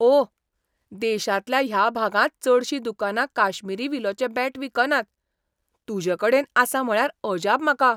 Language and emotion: Goan Konkani, surprised